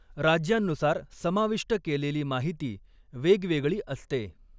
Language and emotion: Marathi, neutral